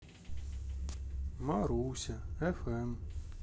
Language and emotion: Russian, sad